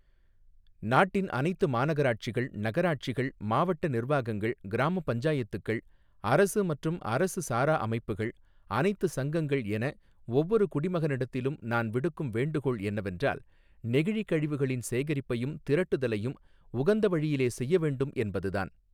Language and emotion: Tamil, neutral